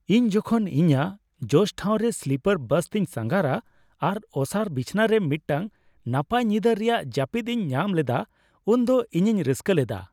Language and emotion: Santali, happy